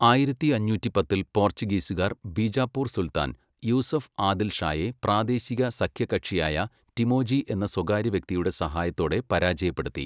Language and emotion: Malayalam, neutral